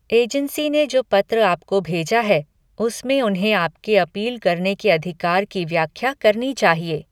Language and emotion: Hindi, neutral